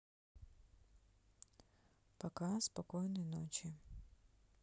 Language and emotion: Russian, neutral